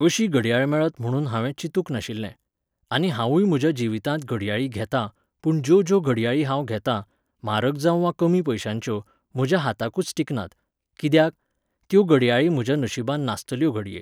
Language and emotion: Goan Konkani, neutral